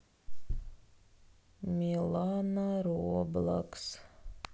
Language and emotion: Russian, sad